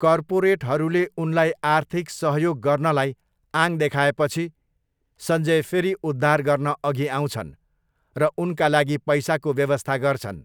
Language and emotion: Nepali, neutral